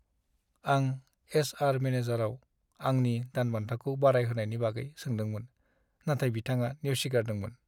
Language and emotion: Bodo, sad